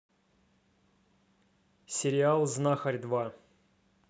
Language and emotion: Russian, neutral